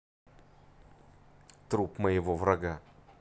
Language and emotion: Russian, neutral